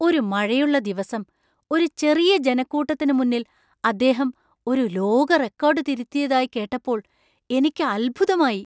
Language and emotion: Malayalam, surprised